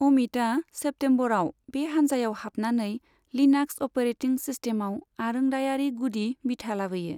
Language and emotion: Bodo, neutral